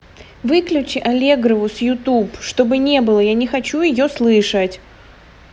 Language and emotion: Russian, angry